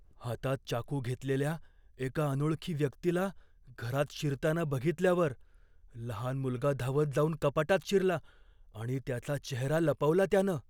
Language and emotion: Marathi, fearful